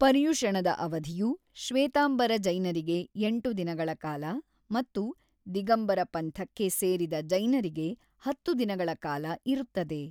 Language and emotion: Kannada, neutral